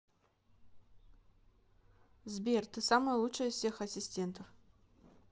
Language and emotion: Russian, neutral